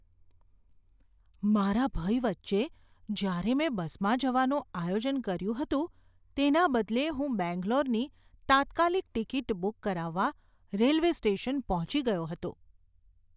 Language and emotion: Gujarati, fearful